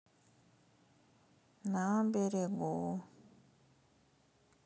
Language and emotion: Russian, sad